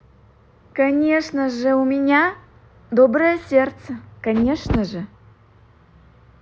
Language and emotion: Russian, positive